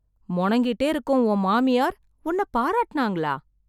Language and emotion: Tamil, surprised